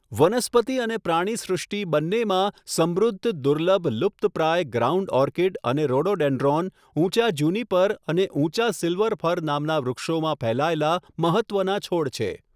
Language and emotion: Gujarati, neutral